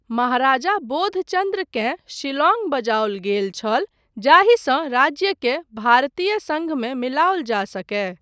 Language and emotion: Maithili, neutral